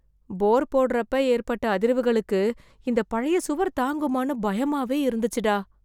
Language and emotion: Tamil, fearful